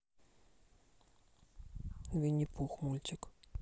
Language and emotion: Russian, neutral